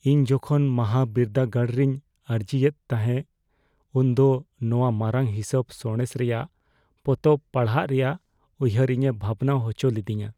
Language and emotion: Santali, fearful